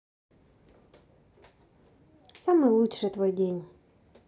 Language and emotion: Russian, positive